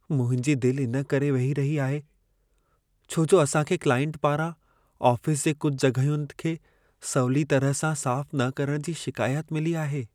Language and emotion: Sindhi, sad